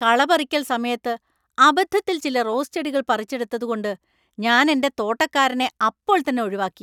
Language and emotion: Malayalam, angry